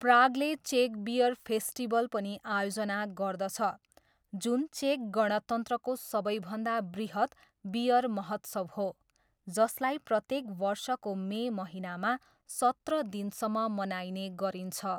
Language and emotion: Nepali, neutral